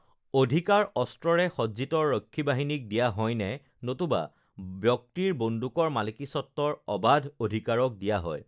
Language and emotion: Assamese, neutral